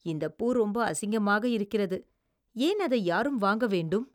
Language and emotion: Tamil, disgusted